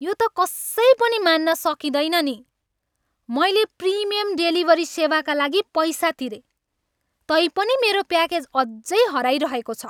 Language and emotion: Nepali, angry